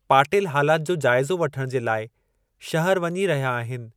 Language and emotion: Sindhi, neutral